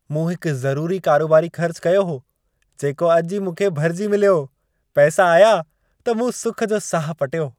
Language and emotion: Sindhi, happy